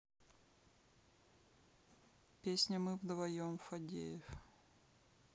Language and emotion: Russian, neutral